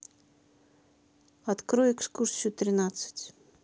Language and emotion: Russian, neutral